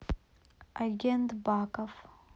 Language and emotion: Russian, neutral